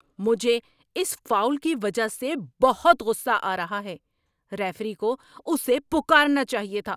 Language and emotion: Urdu, angry